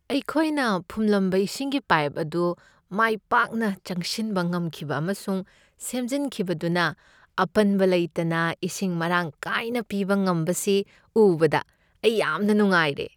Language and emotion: Manipuri, happy